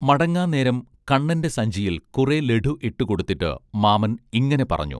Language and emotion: Malayalam, neutral